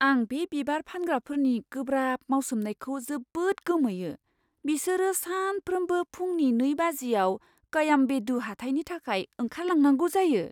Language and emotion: Bodo, surprised